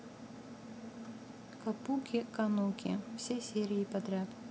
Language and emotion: Russian, neutral